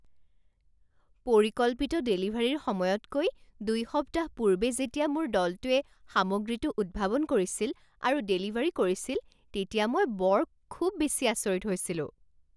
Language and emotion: Assamese, surprised